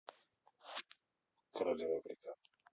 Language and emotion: Russian, neutral